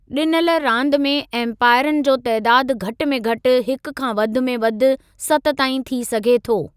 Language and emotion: Sindhi, neutral